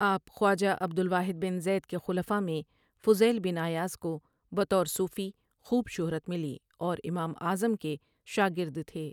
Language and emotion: Urdu, neutral